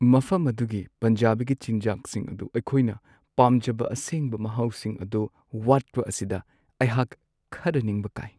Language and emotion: Manipuri, sad